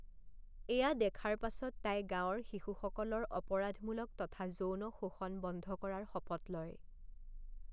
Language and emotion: Assamese, neutral